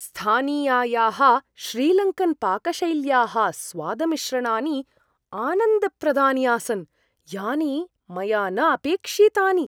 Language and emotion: Sanskrit, surprised